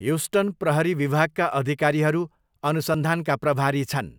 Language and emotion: Nepali, neutral